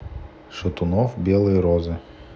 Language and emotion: Russian, neutral